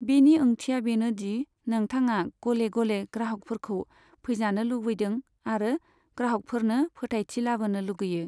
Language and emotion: Bodo, neutral